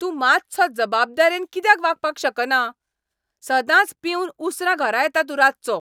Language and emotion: Goan Konkani, angry